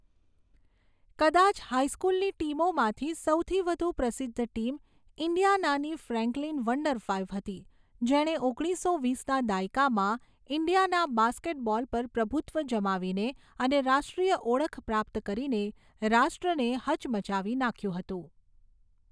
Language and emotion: Gujarati, neutral